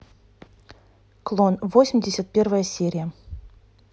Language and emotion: Russian, neutral